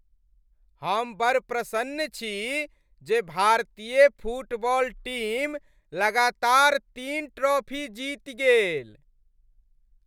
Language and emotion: Maithili, happy